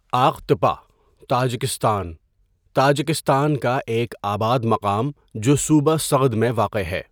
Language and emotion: Urdu, neutral